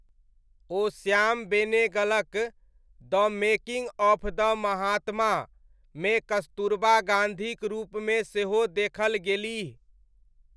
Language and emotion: Maithili, neutral